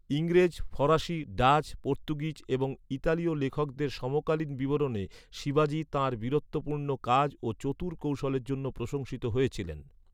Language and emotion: Bengali, neutral